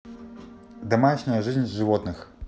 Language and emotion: Russian, neutral